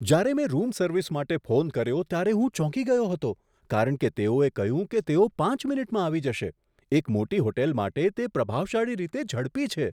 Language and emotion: Gujarati, surprised